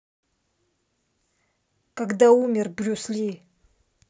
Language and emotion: Russian, neutral